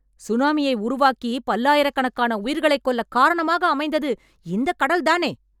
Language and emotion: Tamil, angry